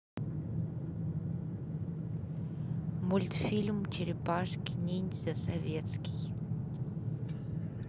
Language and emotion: Russian, neutral